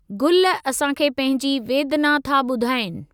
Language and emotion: Sindhi, neutral